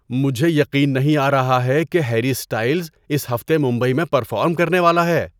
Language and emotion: Urdu, surprised